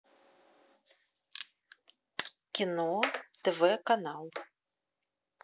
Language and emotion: Russian, neutral